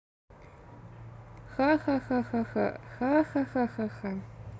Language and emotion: Russian, positive